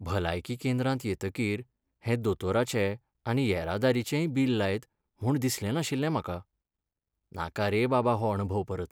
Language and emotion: Goan Konkani, sad